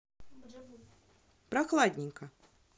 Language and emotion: Russian, neutral